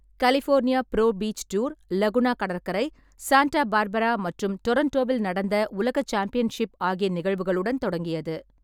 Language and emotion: Tamil, neutral